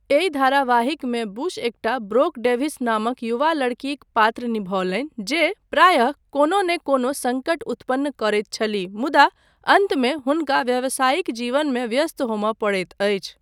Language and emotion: Maithili, neutral